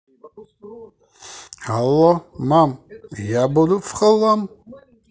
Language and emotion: Russian, positive